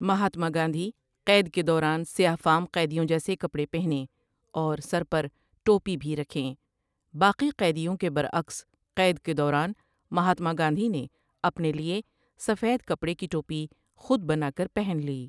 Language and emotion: Urdu, neutral